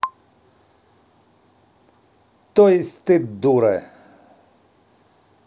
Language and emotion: Russian, positive